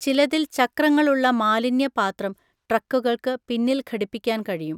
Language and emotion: Malayalam, neutral